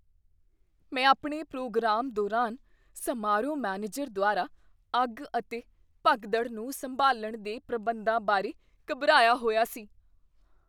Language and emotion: Punjabi, fearful